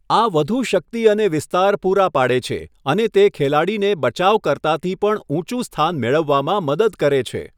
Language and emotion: Gujarati, neutral